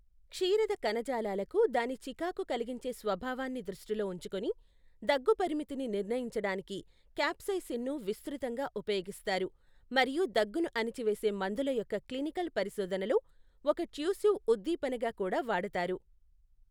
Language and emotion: Telugu, neutral